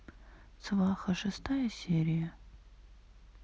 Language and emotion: Russian, sad